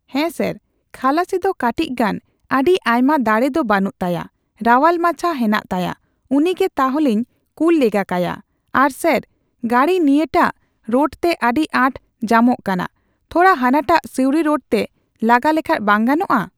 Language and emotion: Santali, neutral